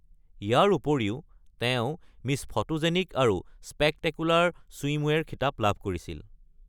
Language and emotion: Assamese, neutral